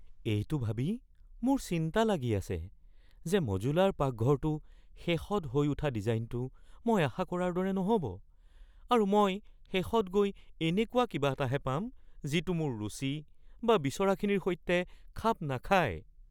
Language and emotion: Assamese, fearful